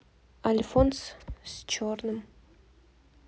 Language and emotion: Russian, neutral